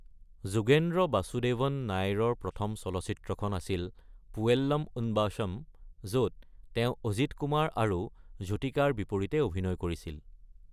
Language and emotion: Assamese, neutral